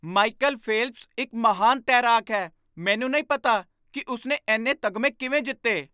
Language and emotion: Punjabi, surprised